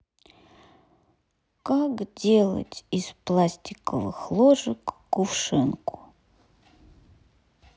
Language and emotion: Russian, sad